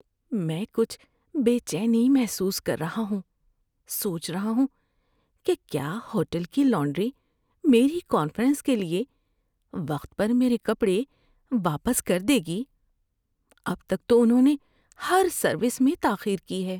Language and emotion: Urdu, fearful